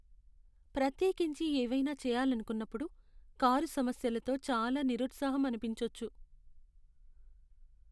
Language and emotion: Telugu, sad